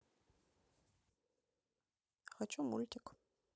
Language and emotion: Russian, neutral